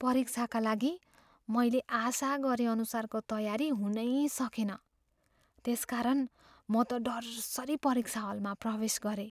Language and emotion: Nepali, fearful